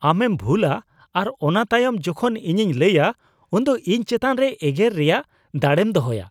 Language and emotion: Santali, disgusted